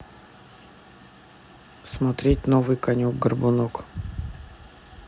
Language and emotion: Russian, neutral